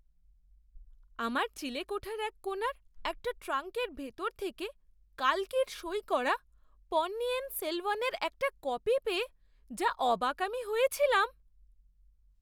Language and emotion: Bengali, surprised